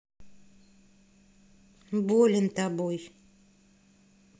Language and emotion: Russian, neutral